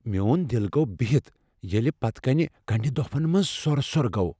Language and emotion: Kashmiri, fearful